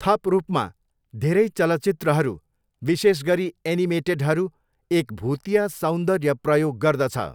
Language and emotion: Nepali, neutral